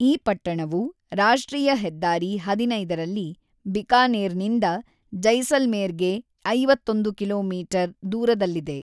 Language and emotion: Kannada, neutral